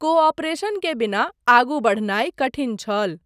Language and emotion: Maithili, neutral